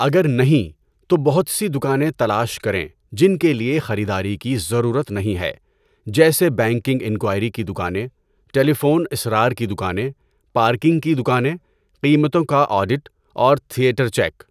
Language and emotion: Urdu, neutral